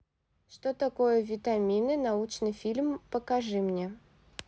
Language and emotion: Russian, neutral